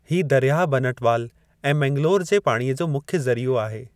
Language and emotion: Sindhi, neutral